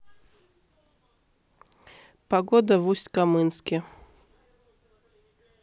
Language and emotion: Russian, neutral